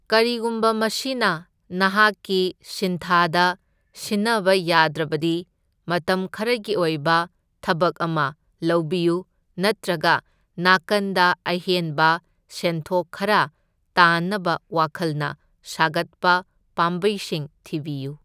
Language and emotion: Manipuri, neutral